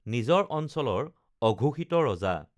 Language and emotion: Assamese, neutral